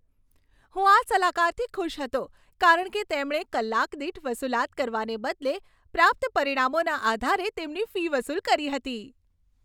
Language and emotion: Gujarati, happy